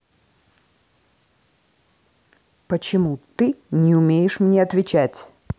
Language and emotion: Russian, angry